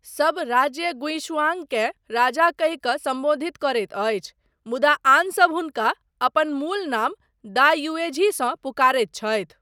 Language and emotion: Maithili, neutral